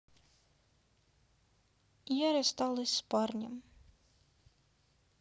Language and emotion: Russian, sad